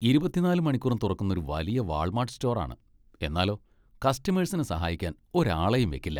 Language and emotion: Malayalam, disgusted